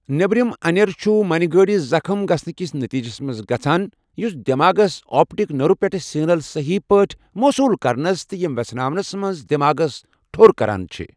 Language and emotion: Kashmiri, neutral